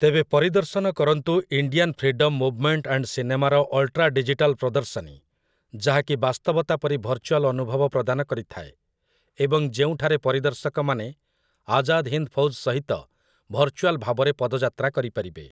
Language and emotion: Odia, neutral